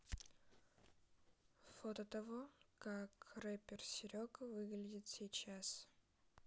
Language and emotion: Russian, neutral